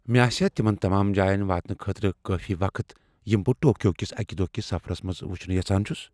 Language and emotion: Kashmiri, fearful